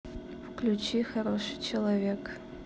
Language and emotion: Russian, neutral